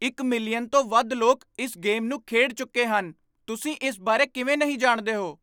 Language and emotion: Punjabi, surprised